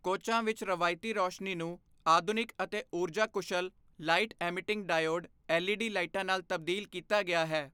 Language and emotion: Punjabi, neutral